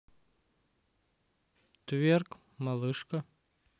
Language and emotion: Russian, neutral